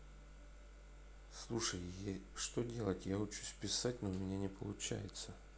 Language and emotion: Russian, neutral